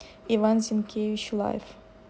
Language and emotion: Russian, neutral